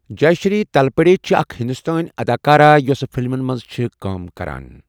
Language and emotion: Kashmiri, neutral